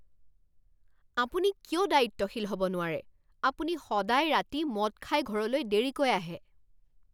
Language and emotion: Assamese, angry